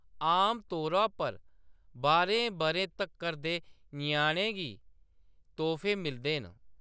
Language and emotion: Dogri, neutral